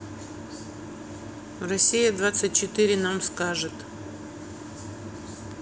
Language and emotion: Russian, neutral